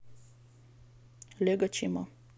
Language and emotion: Russian, neutral